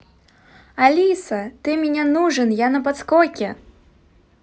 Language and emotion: Russian, positive